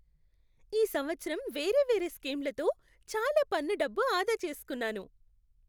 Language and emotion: Telugu, happy